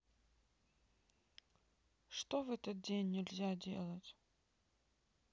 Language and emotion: Russian, sad